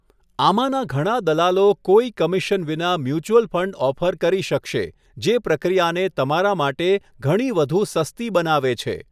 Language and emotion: Gujarati, neutral